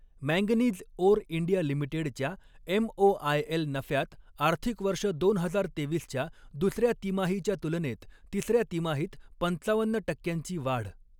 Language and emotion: Marathi, neutral